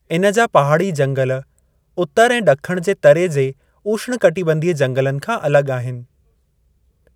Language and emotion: Sindhi, neutral